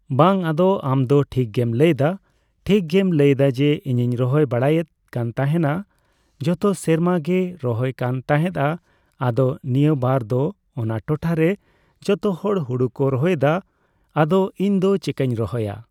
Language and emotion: Santali, neutral